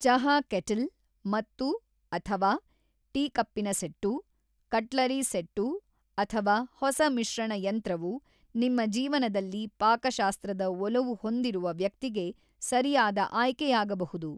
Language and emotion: Kannada, neutral